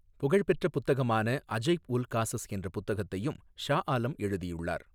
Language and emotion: Tamil, neutral